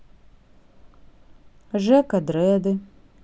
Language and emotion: Russian, neutral